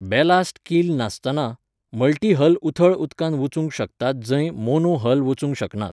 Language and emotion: Goan Konkani, neutral